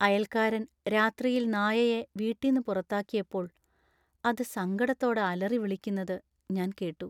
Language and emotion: Malayalam, sad